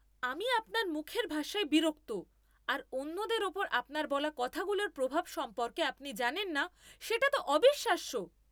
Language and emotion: Bengali, angry